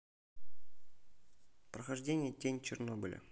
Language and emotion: Russian, neutral